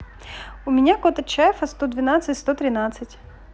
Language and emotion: Russian, positive